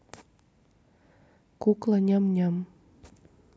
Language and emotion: Russian, neutral